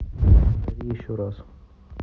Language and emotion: Russian, neutral